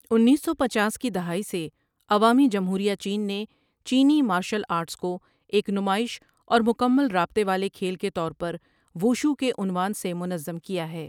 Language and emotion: Urdu, neutral